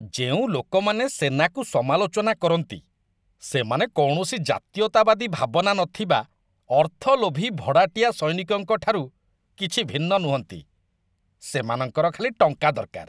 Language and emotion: Odia, disgusted